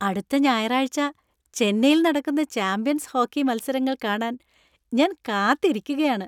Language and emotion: Malayalam, happy